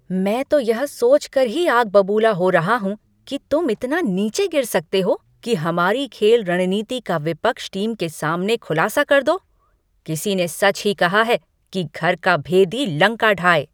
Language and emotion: Hindi, angry